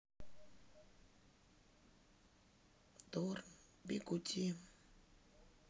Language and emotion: Russian, sad